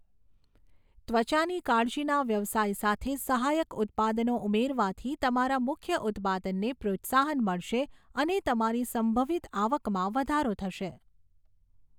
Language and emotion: Gujarati, neutral